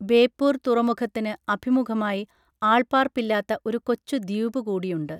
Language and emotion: Malayalam, neutral